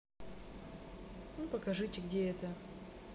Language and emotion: Russian, neutral